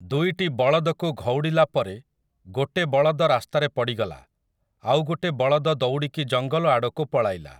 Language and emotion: Odia, neutral